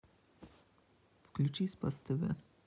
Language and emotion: Russian, neutral